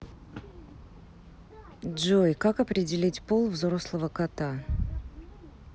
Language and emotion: Russian, neutral